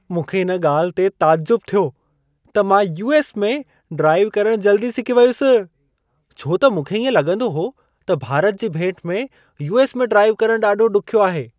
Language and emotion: Sindhi, surprised